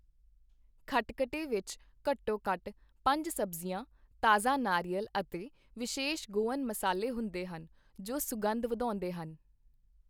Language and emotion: Punjabi, neutral